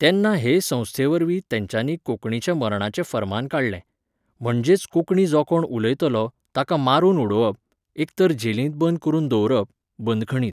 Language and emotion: Goan Konkani, neutral